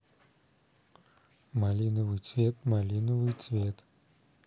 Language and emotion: Russian, neutral